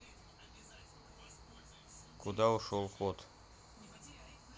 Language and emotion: Russian, neutral